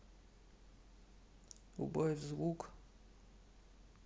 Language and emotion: Russian, sad